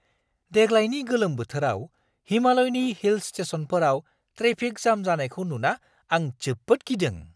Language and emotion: Bodo, surprised